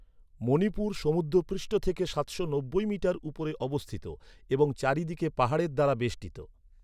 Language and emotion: Bengali, neutral